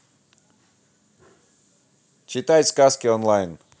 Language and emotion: Russian, positive